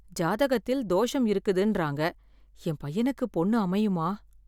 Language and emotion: Tamil, fearful